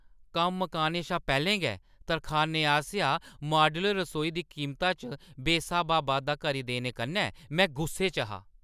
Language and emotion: Dogri, angry